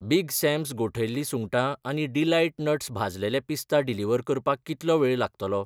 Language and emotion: Goan Konkani, neutral